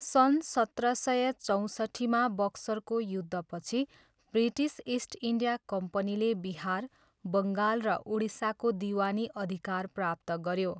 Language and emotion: Nepali, neutral